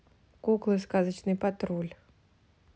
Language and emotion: Russian, neutral